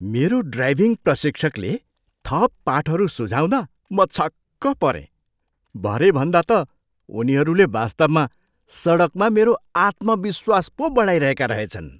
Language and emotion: Nepali, surprised